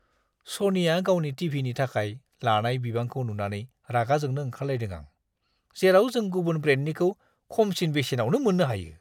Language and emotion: Bodo, disgusted